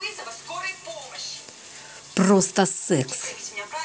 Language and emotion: Russian, angry